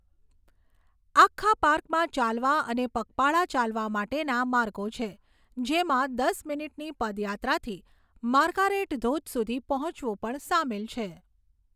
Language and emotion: Gujarati, neutral